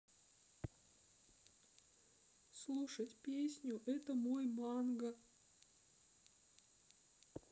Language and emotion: Russian, sad